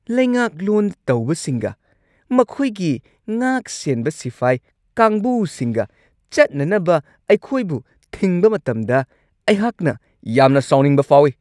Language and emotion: Manipuri, angry